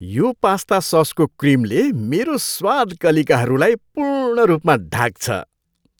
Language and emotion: Nepali, happy